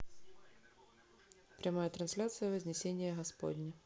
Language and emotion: Russian, neutral